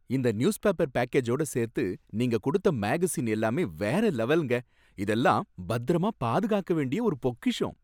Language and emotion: Tamil, happy